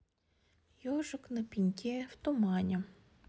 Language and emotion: Russian, sad